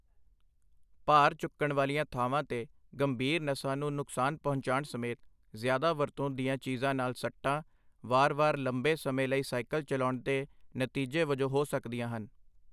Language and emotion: Punjabi, neutral